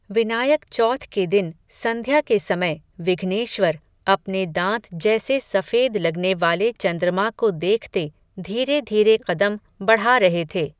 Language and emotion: Hindi, neutral